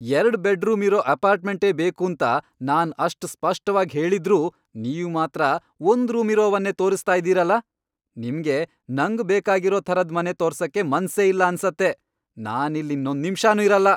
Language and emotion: Kannada, angry